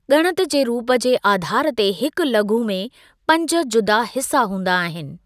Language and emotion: Sindhi, neutral